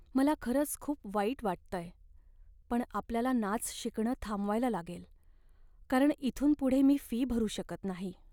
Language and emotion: Marathi, sad